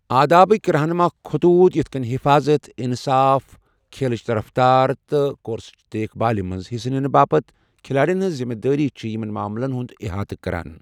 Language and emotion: Kashmiri, neutral